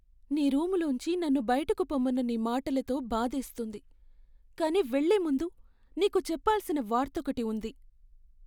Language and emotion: Telugu, sad